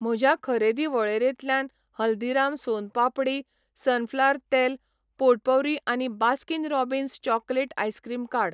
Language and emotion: Goan Konkani, neutral